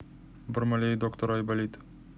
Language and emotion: Russian, neutral